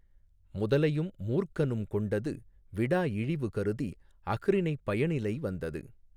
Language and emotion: Tamil, neutral